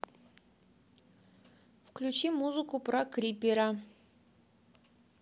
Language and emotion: Russian, neutral